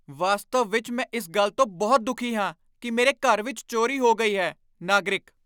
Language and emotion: Punjabi, angry